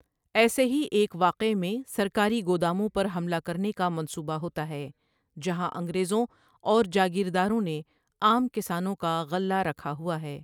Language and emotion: Urdu, neutral